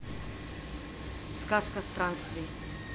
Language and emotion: Russian, neutral